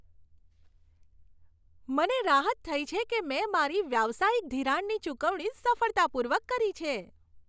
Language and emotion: Gujarati, happy